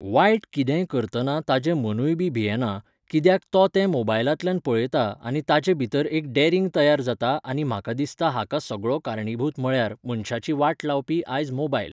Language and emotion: Goan Konkani, neutral